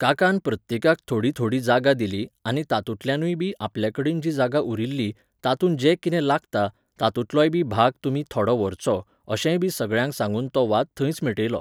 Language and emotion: Goan Konkani, neutral